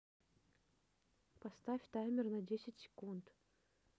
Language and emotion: Russian, neutral